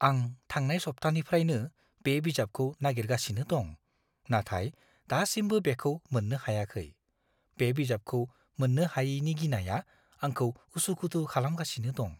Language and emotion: Bodo, fearful